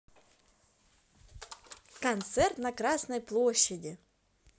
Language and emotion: Russian, positive